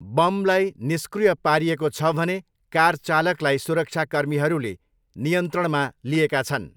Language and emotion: Nepali, neutral